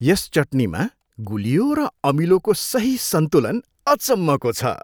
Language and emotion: Nepali, happy